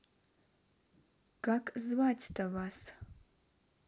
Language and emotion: Russian, neutral